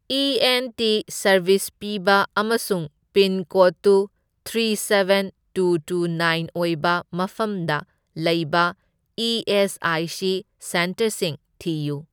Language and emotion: Manipuri, neutral